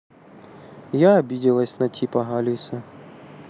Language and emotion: Russian, sad